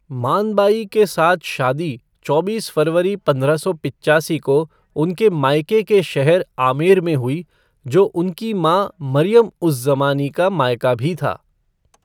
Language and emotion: Hindi, neutral